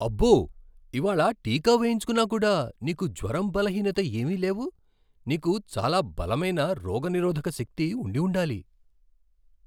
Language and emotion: Telugu, surprised